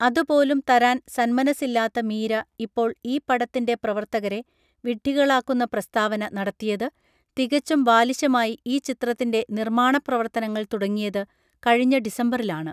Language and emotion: Malayalam, neutral